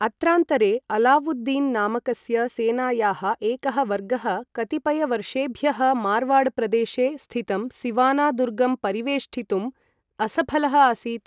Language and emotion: Sanskrit, neutral